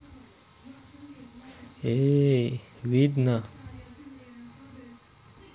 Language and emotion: Russian, neutral